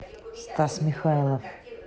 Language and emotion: Russian, neutral